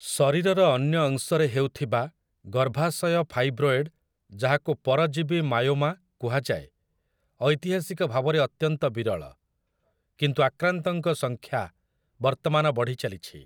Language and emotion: Odia, neutral